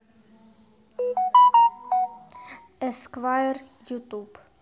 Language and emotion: Russian, neutral